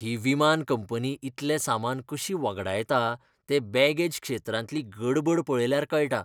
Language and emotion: Goan Konkani, disgusted